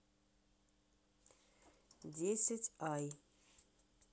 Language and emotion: Russian, neutral